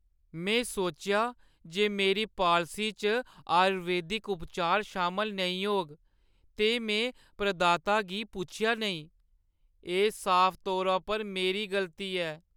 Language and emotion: Dogri, sad